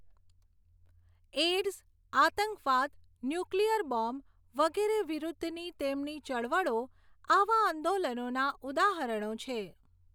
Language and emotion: Gujarati, neutral